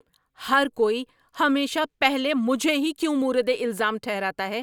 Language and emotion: Urdu, angry